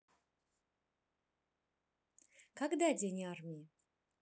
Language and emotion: Russian, neutral